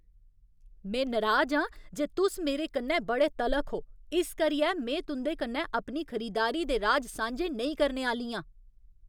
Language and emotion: Dogri, angry